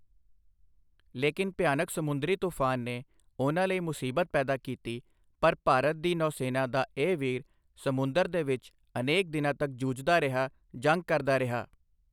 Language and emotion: Punjabi, neutral